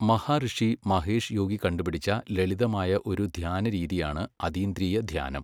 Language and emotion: Malayalam, neutral